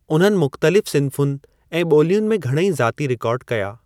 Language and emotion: Sindhi, neutral